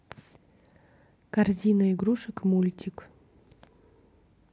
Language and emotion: Russian, neutral